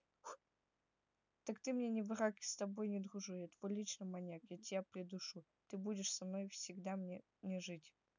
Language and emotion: Russian, neutral